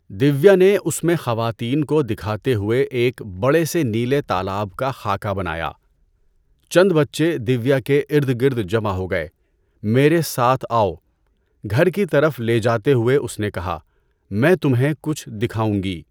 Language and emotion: Urdu, neutral